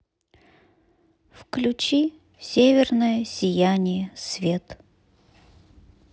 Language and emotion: Russian, sad